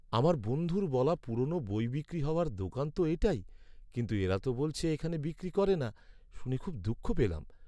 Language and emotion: Bengali, sad